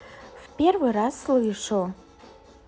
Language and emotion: Russian, neutral